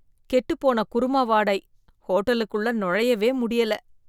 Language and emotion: Tamil, disgusted